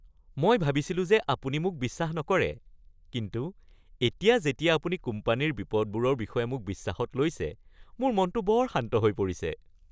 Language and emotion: Assamese, happy